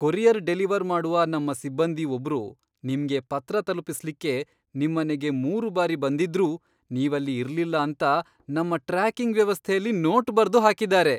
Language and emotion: Kannada, surprised